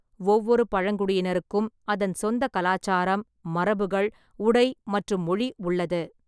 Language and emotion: Tamil, neutral